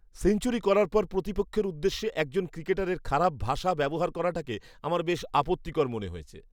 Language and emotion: Bengali, disgusted